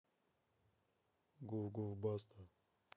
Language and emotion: Russian, neutral